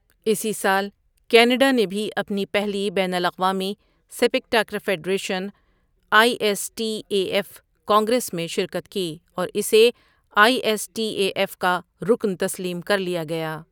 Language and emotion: Urdu, neutral